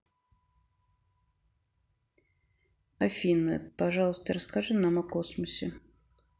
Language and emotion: Russian, neutral